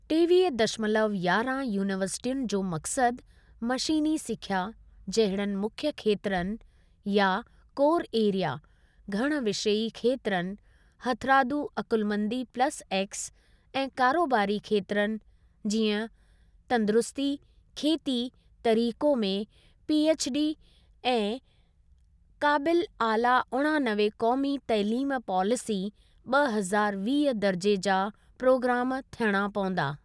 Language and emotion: Sindhi, neutral